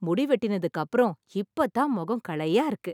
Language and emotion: Tamil, happy